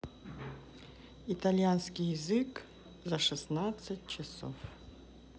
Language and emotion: Russian, neutral